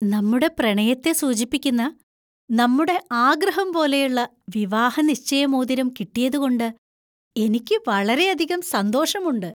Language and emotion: Malayalam, happy